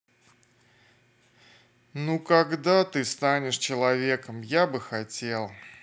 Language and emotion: Russian, sad